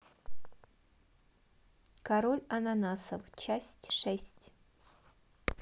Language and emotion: Russian, neutral